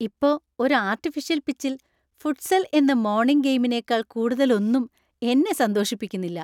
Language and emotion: Malayalam, happy